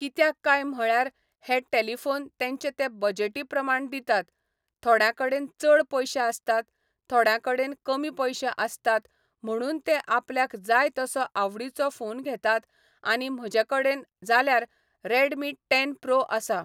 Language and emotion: Goan Konkani, neutral